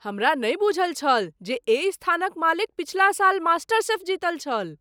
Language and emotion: Maithili, surprised